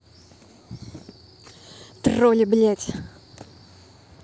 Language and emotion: Russian, angry